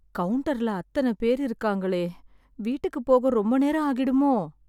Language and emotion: Tamil, sad